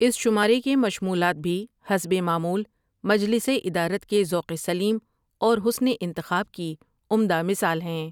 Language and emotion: Urdu, neutral